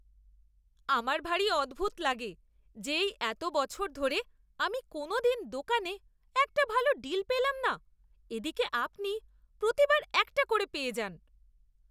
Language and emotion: Bengali, disgusted